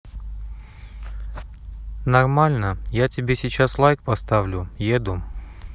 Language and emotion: Russian, neutral